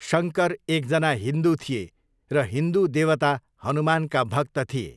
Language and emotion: Nepali, neutral